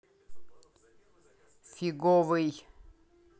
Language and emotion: Russian, angry